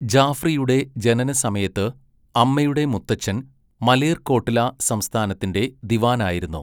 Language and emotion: Malayalam, neutral